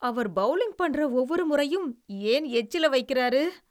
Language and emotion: Tamil, disgusted